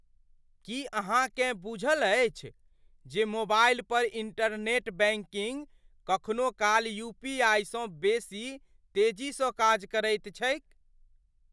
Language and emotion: Maithili, surprised